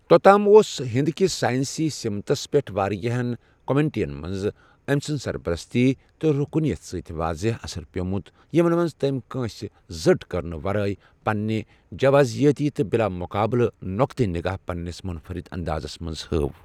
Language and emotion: Kashmiri, neutral